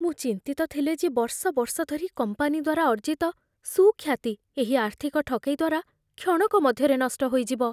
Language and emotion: Odia, fearful